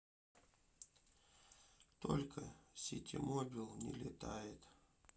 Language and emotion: Russian, sad